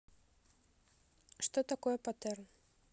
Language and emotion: Russian, neutral